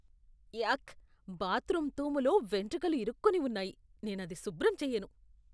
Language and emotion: Telugu, disgusted